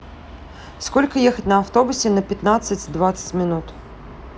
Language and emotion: Russian, neutral